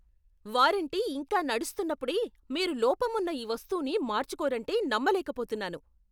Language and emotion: Telugu, angry